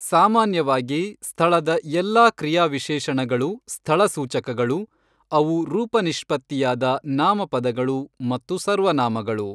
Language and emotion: Kannada, neutral